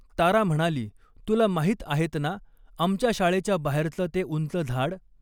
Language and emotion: Marathi, neutral